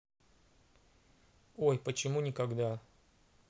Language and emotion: Russian, neutral